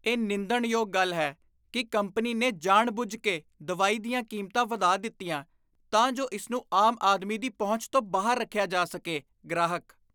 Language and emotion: Punjabi, disgusted